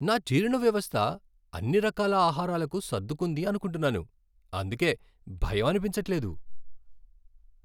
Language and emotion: Telugu, happy